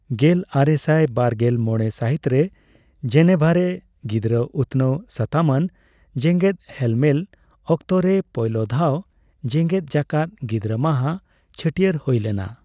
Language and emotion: Santali, neutral